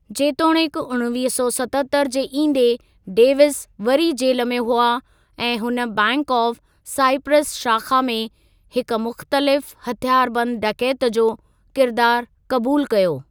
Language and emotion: Sindhi, neutral